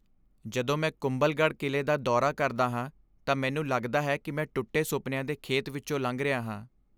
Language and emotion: Punjabi, sad